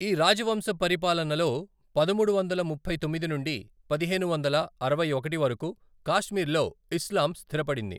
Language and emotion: Telugu, neutral